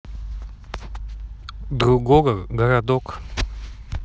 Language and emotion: Russian, neutral